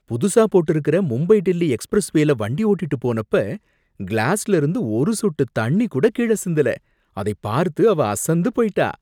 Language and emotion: Tamil, surprised